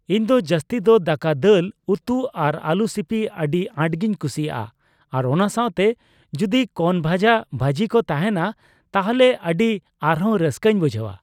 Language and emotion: Santali, neutral